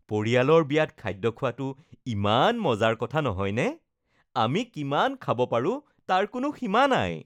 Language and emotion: Assamese, happy